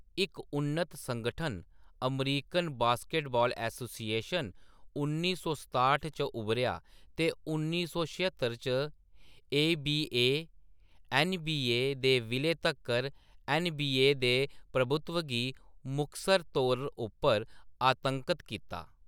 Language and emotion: Dogri, neutral